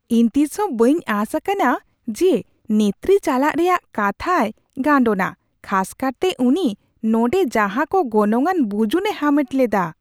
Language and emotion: Santali, surprised